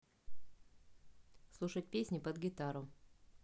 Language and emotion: Russian, neutral